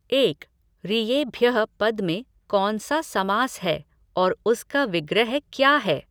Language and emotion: Hindi, neutral